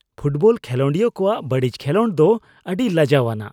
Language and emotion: Santali, disgusted